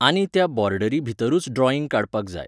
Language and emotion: Goan Konkani, neutral